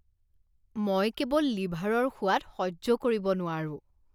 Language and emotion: Assamese, disgusted